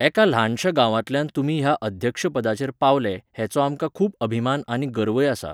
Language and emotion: Goan Konkani, neutral